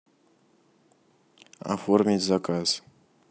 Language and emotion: Russian, neutral